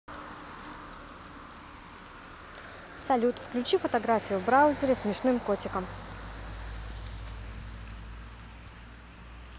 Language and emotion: Russian, neutral